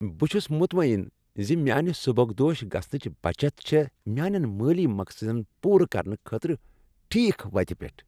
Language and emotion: Kashmiri, happy